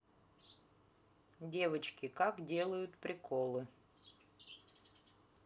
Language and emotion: Russian, neutral